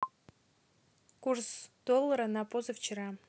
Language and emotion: Russian, neutral